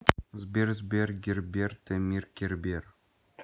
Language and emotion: Russian, neutral